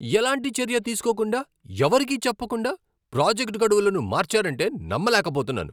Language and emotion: Telugu, angry